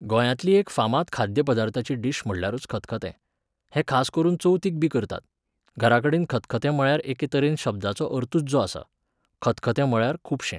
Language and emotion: Goan Konkani, neutral